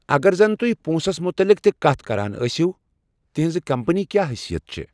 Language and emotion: Kashmiri, neutral